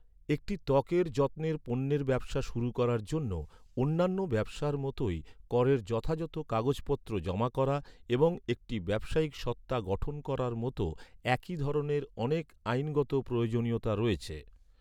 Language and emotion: Bengali, neutral